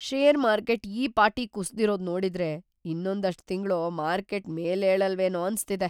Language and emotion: Kannada, fearful